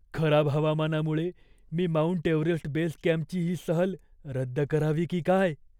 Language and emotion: Marathi, fearful